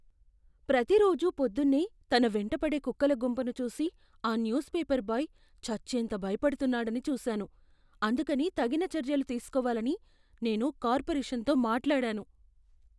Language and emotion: Telugu, fearful